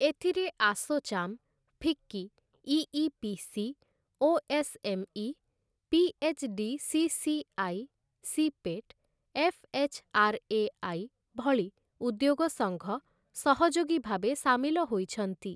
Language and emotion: Odia, neutral